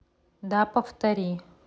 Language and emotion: Russian, neutral